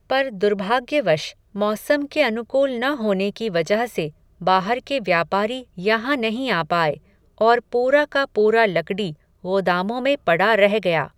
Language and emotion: Hindi, neutral